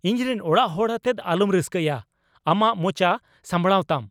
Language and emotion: Santali, angry